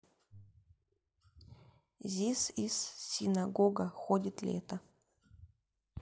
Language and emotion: Russian, neutral